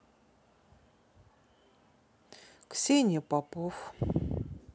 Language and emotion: Russian, neutral